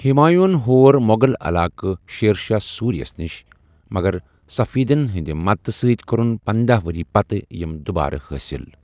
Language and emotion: Kashmiri, neutral